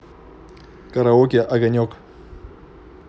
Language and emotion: Russian, neutral